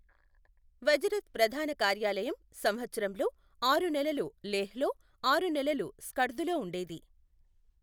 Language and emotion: Telugu, neutral